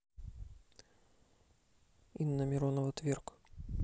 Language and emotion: Russian, neutral